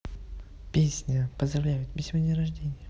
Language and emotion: Russian, neutral